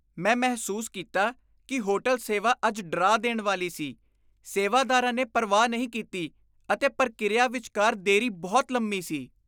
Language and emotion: Punjabi, disgusted